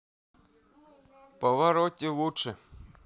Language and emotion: Russian, positive